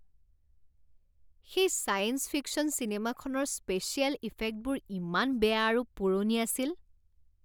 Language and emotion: Assamese, disgusted